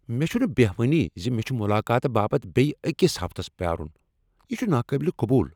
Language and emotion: Kashmiri, angry